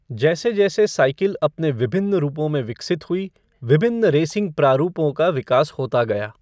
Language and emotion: Hindi, neutral